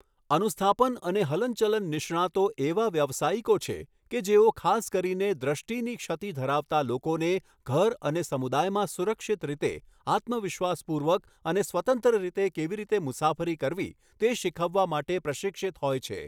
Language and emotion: Gujarati, neutral